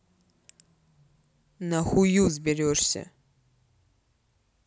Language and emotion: Russian, angry